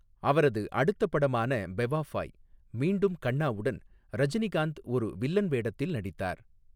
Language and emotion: Tamil, neutral